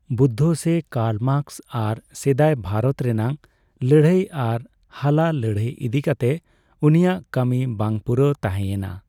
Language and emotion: Santali, neutral